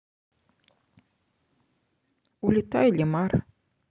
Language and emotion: Russian, neutral